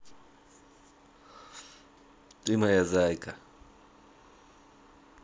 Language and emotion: Russian, positive